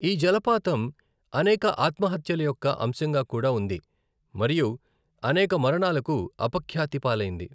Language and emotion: Telugu, neutral